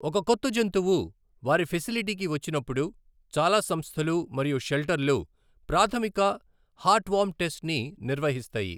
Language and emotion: Telugu, neutral